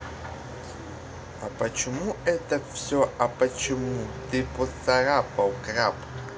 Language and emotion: Russian, neutral